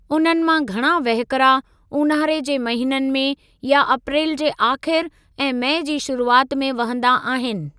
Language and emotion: Sindhi, neutral